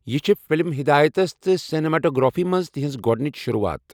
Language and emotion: Kashmiri, neutral